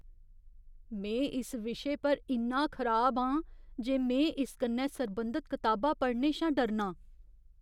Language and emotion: Dogri, fearful